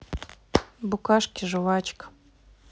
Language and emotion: Russian, neutral